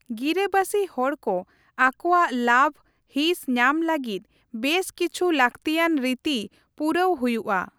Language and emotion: Santali, neutral